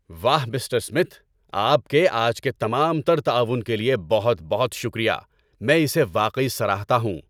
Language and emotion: Urdu, happy